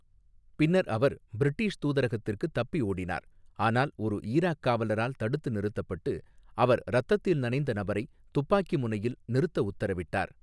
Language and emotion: Tamil, neutral